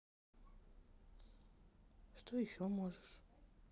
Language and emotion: Russian, neutral